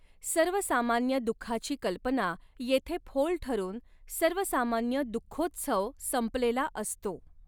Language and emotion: Marathi, neutral